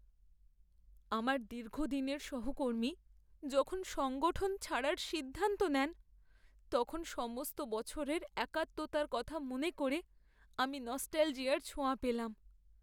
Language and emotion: Bengali, sad